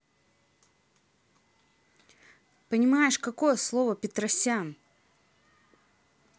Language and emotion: Russian, angry